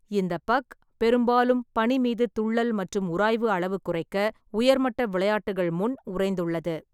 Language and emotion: Tamil, neutral